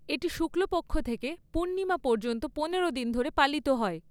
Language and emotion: Bengali, neutral